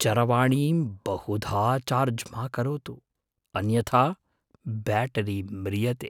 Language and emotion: Sanskrit, fearful